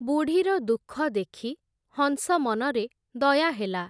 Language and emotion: Odia, neutral